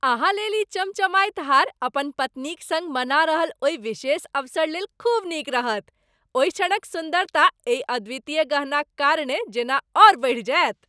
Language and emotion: Maithili, happy